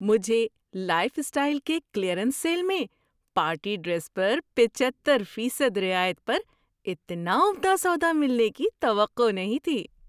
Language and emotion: Urdu, surprised